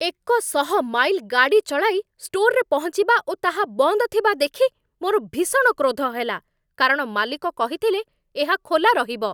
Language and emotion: Odia, angry